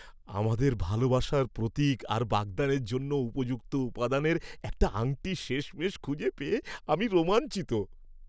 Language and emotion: Bengali, happy